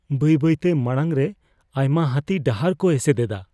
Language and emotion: Santali, fearful